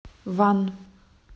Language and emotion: Russian, neutral